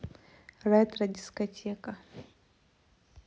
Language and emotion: Russian, neutral